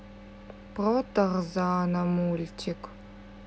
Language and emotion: Russian, sad